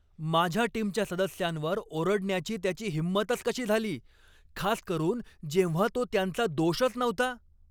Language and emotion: Marathi, angry